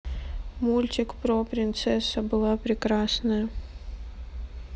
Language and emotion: Russian, sad